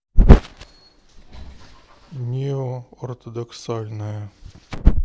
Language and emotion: Russian, neutral